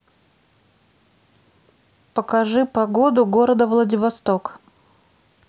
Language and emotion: Russian, neutral